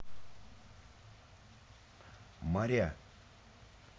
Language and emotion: Russian, neutral